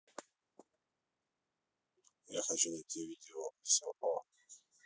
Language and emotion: Russian, neutral